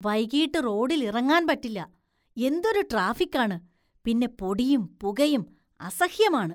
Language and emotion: Malayalam, disgusted